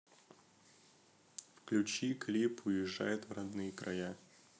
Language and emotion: Russian, neutral